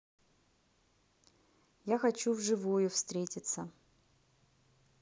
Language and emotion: Russian, neutral